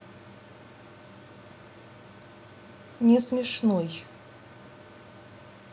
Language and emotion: Russian, neutral